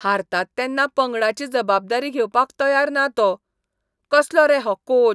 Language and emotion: Goan Konkani, disgusted